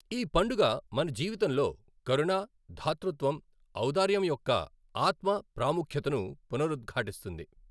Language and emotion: Telugu, neutral